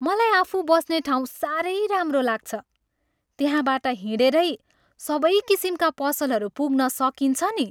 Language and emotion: Nepali, happy